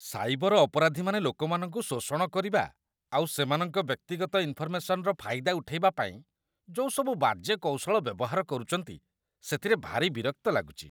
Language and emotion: Odia, disgusted